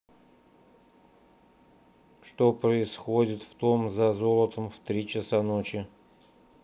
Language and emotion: Russian, neutral